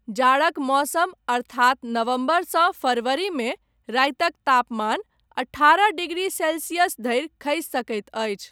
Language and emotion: Maithili, neutral